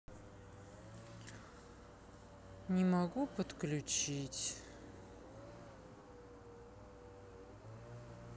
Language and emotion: Russian, sad